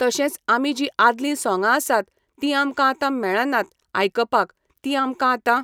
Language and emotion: Goan Konkani, neutral